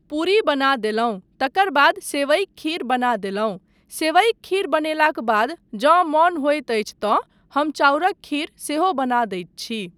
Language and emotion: Maithili, neutral